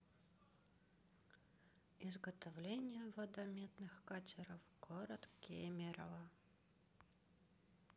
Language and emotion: Russian, sad